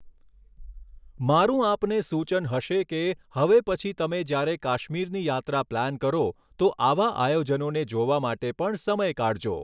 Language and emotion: Gujarati, neutral